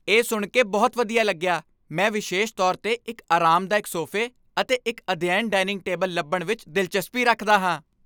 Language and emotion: Punjabi, happy